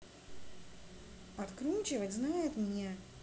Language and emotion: Russian, neutral